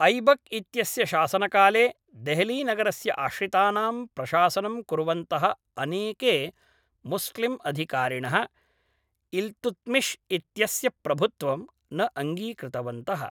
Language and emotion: Sanskrit, neutral